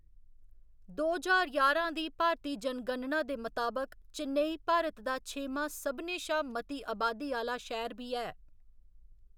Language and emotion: Dogri, neutral